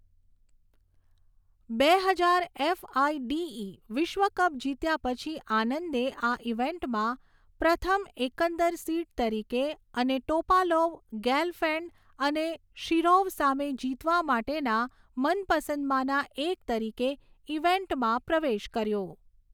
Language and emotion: Gujarati, neutral